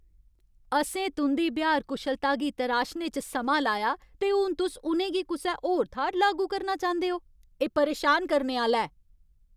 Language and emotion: Dogri, angry